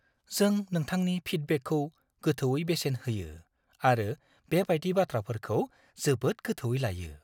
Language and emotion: Bodo, fearful